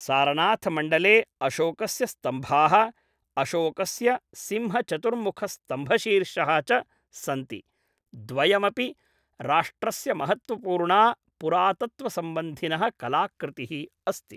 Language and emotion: Sanskrit, neutral